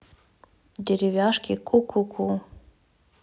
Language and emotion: Russian, neutral